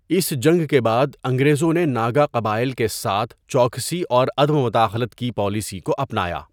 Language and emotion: Urdu, neutral